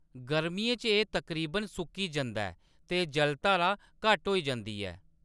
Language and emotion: Dogri, neutral